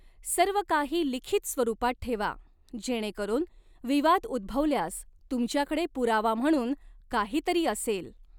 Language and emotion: Marathi, neutral